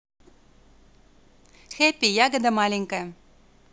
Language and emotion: Russian, positive